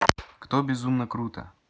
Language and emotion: Russian, neutral